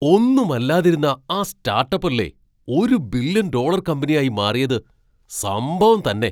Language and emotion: Malayalam, surprised